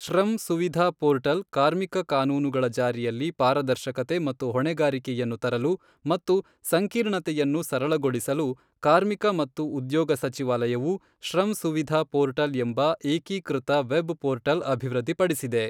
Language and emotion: Kannada, neutral